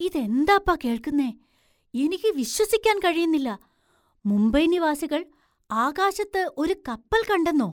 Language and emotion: Malayalam, surprised